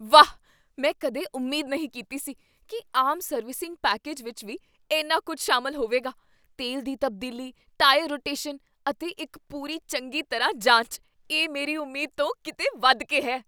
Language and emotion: Punjabi, surprised